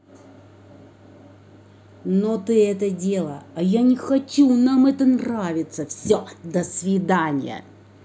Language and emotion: Russian, angry